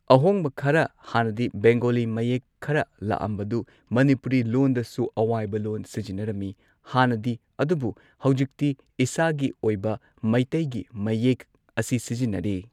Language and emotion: Manipuri, neutral